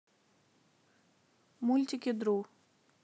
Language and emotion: Russian, neutral